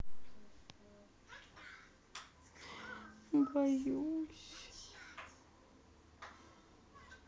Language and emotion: Russian, sad